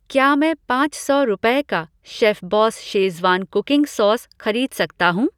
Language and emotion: Hindi, neutral